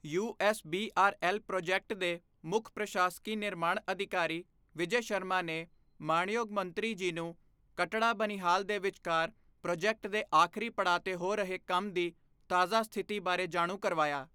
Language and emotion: Punjabi, neutral